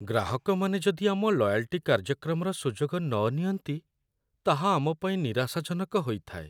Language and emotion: Odia, sad